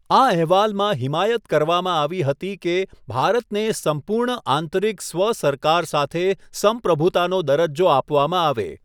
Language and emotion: Gujarati, neutral